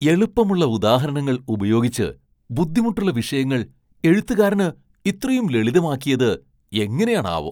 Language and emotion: Malayalam, surprised